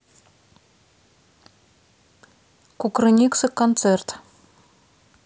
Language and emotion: Russian, neutral